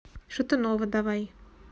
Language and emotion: Russian, neutral